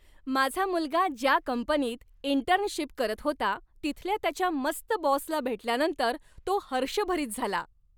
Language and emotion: Marathi, happy